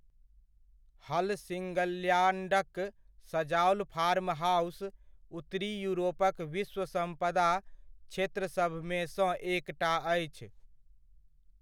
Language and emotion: Maithili, neutral